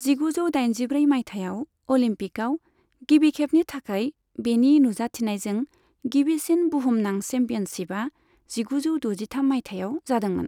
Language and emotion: Bodo, neutral